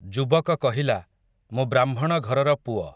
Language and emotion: Odia, neutral